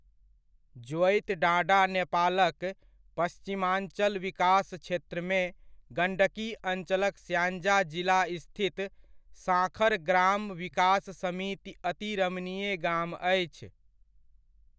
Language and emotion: Maithili, neutral